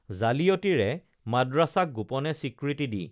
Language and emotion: Assamese, neutral